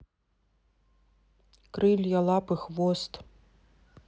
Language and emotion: Russian, neutral